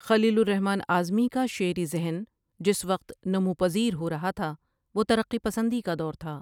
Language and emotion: Urdu, neutral